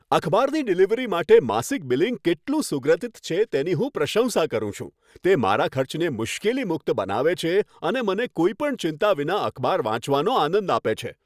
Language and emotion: Gujarati, happy